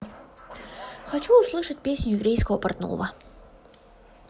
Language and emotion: Russian, positive